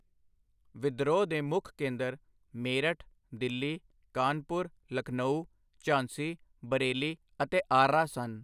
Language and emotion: Punjabi, neutral